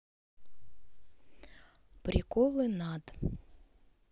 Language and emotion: Russian, sad